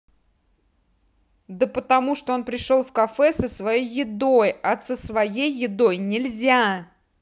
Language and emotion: Russian, angry